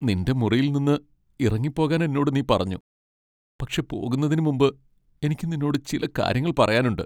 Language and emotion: Malayalam, sad